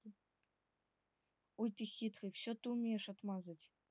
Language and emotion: Russian, neutral